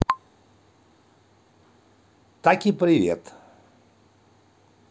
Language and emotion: Russian, positive